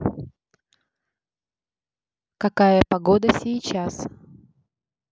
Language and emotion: Russian, neutral